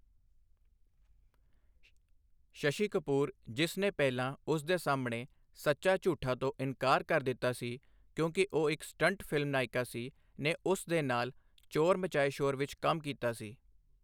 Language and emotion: Punjabi, neutral